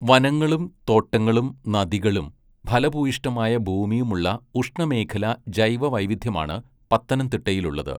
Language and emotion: Malayalam, neutral